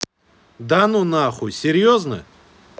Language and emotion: Russian, angry